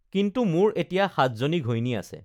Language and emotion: Assamese, neutral